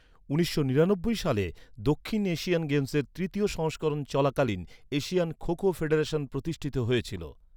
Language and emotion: Bengali, neutral